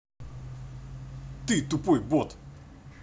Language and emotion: Russian, angry